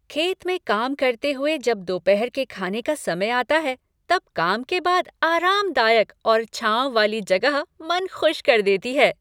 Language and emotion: Hindi, happy